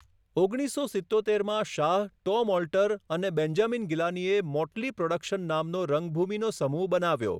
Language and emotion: Gujarati, neutral